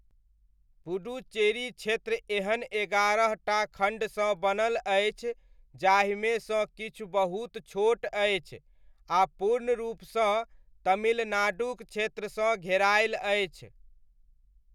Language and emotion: Maithili, neutral